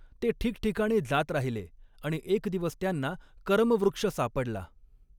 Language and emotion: Marathi, neutral